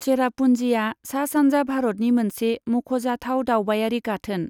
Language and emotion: Bodo, neutral